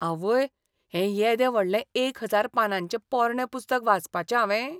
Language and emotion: Goan Konkani, disgusted